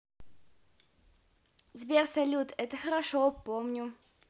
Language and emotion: Russian, positive